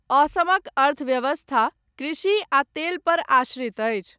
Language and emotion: Maithili, neutral